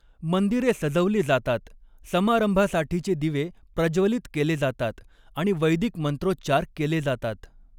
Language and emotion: Marathi, neutral